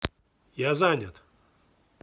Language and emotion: Russian, angry